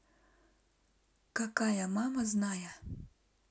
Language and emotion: Russian, neutral